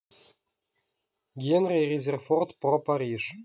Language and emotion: Russian, neutral